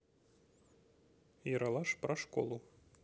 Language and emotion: Russian, neutral